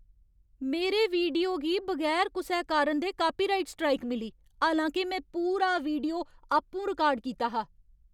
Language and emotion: Dogri, angry